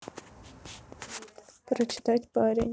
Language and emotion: Russian, neutral